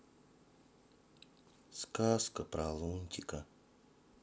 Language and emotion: Russian, sad